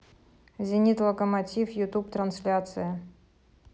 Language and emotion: Russian, neutral